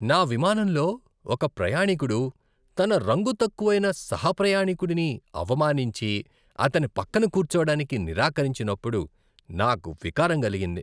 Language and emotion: Telugu, disgusted